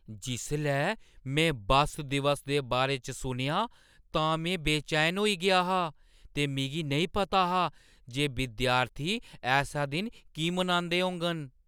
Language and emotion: Dogri, surprised